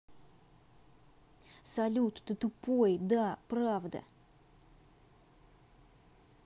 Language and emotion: Russian, angry